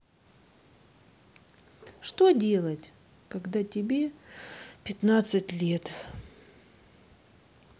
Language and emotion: Russian, sad